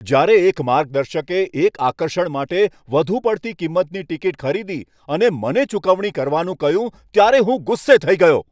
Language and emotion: Gujarati, angry